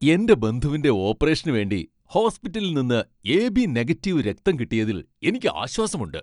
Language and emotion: Malayalam, happy